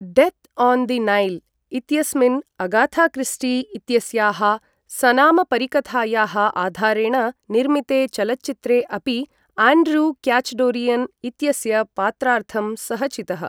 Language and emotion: Sanskrit, neutral